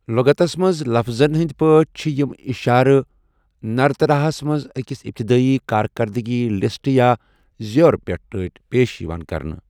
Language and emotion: Kashmiri, neutral